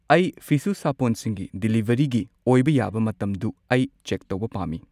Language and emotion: Manipuri, neutral